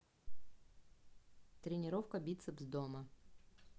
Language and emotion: Russian, neutral